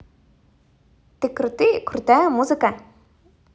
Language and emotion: Russian, positive